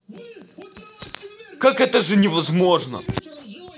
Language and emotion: Russian, angry